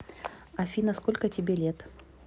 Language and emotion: Russian, neutral